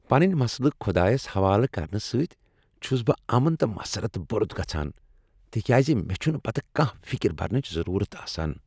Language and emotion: Kashmiri, happy